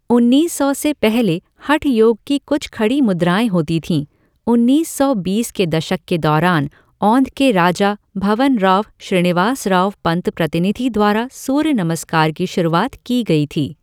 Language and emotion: Hindi, neutral